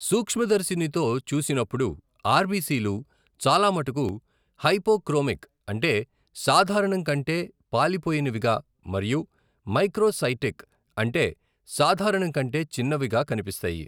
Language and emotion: Telugu, neutral